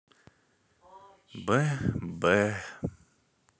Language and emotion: Russian, sad